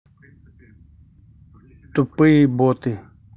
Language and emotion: Russian, angry